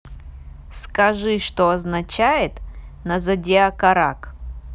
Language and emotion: Russian, neutral